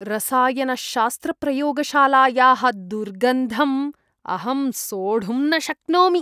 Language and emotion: Sanskrit, disgusted